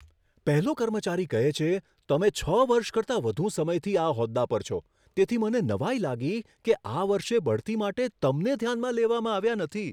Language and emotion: Gujarati, surprised